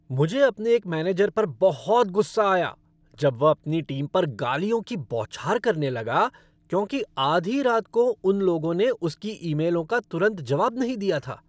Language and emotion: Hindi, angry